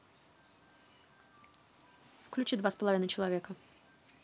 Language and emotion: Russian, neutral